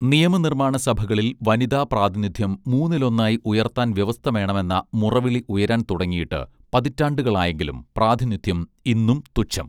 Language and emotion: Malayalam, neutral